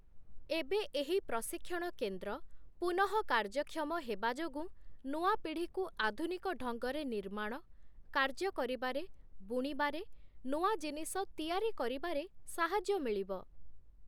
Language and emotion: Odia, neutral